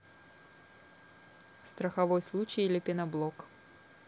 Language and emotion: Russian, neutral